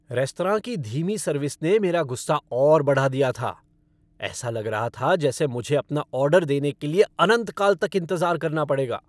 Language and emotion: Hindi, angry